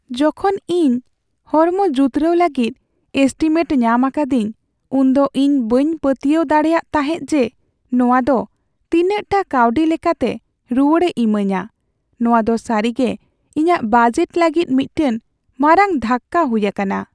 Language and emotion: Santali, sad